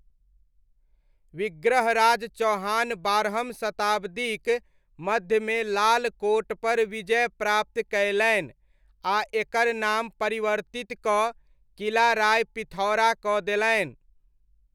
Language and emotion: Maithili, neutral